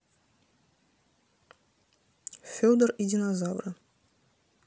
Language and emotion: Russian, neutral